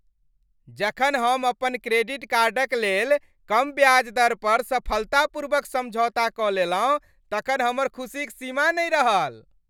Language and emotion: Maithili, happy